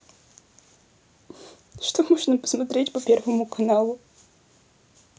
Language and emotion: Russian, sad